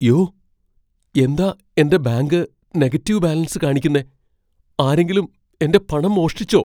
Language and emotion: Malayalam, fearful